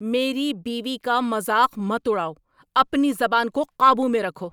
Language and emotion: Urdu, angry